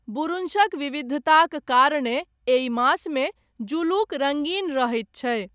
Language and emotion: Maithili, neutral